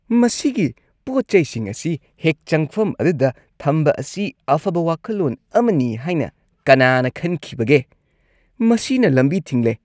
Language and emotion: Manipuri, disgusted